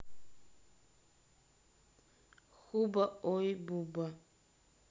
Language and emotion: Russian, neutral